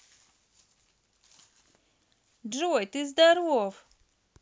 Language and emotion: Russian, positive